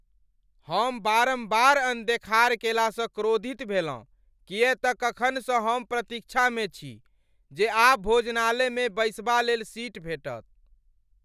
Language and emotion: Maithili, angry